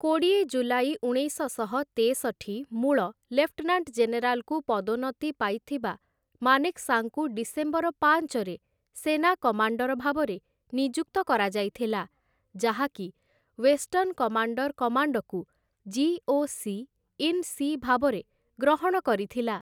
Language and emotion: Odia, neutral